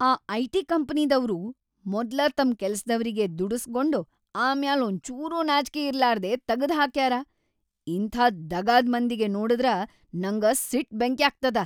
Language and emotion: Kannada, angry